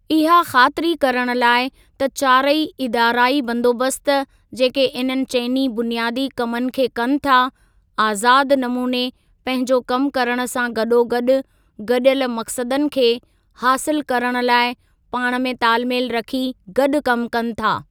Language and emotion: Sindhi, neutral